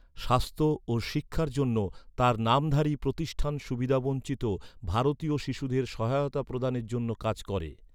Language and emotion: Bengali, neutral